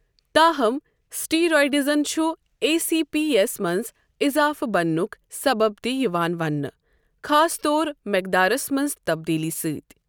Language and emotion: Kashmiri, neutral